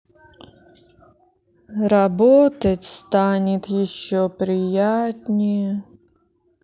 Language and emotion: Russian, sad